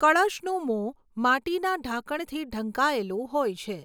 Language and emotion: Gujarati, neutral